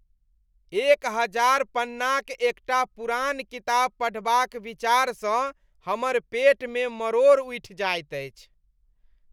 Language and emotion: Maithili, disgusted